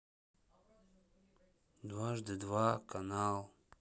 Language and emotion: Russian, sad